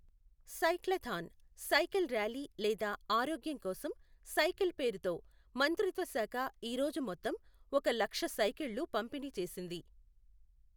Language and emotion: Telugu, neutral